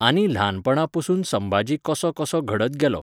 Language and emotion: Goan Konkani, neutral